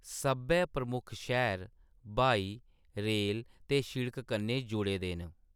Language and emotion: Dogri, neutral